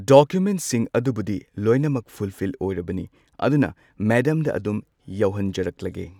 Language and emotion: Manipuri, neutral